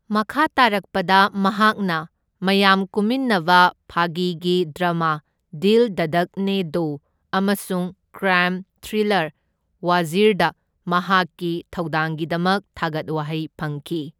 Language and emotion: Manipuri, neutral